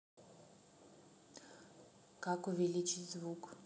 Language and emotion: Russian, neutral